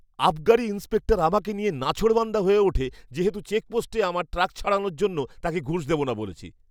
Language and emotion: Bengali, angry